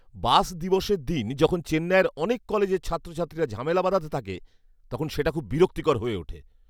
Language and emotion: Bengali, angry